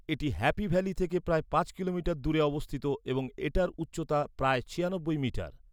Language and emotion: Bengali, neutral